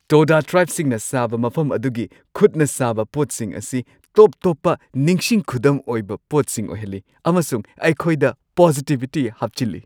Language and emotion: Manipuri, happy